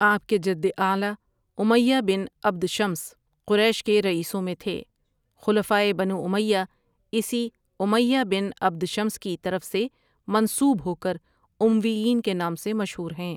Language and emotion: Urdu, neutral